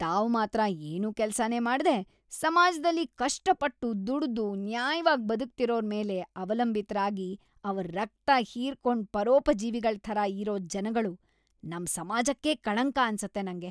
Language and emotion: Kannada, disgusted